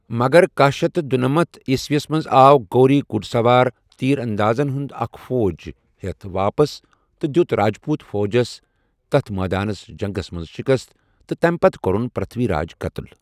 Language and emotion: Kashmiri, neutral